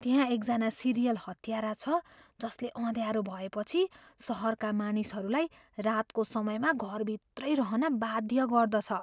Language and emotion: Nepali, fearful